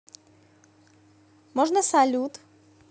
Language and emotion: Russian, neutral